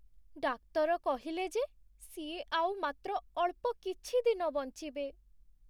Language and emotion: Odia, sad